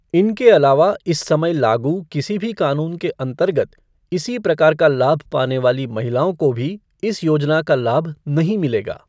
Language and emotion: Hindi, neutral